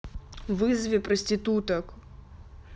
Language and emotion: Russian, angry